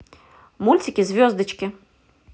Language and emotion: Russian, positive